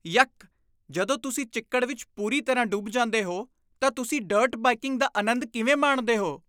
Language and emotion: Punjabi, disgusted